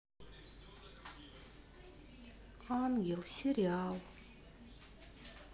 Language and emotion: Russian, sad